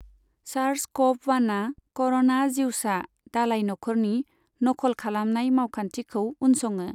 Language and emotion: Bodo, neutral